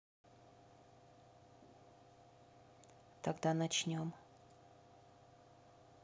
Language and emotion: Russian, neutral